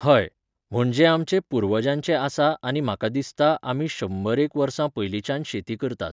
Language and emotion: Goan Konkani, neutral